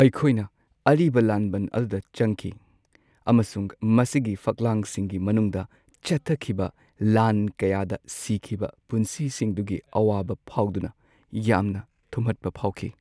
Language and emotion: Manipuri, sad